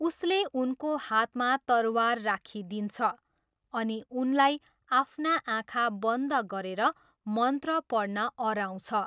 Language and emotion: Nepali, neutral